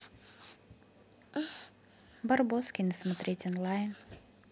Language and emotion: Russian, positive